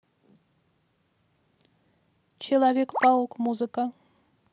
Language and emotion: Russian, neutral